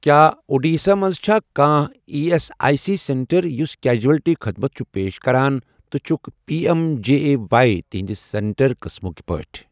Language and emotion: Kashmiri, neutral